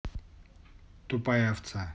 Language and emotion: Russian, neutral